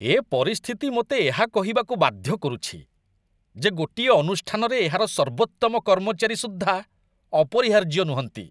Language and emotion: Odia, disgusted